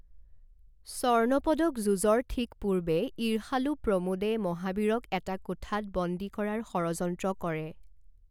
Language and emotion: Assamese, neutral